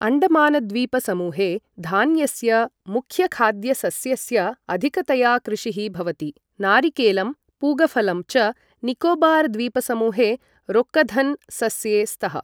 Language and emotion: Sanskrit, neutral